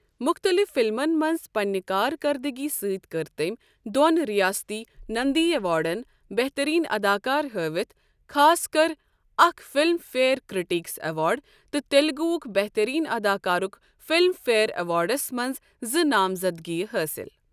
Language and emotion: Kashmiri, neutral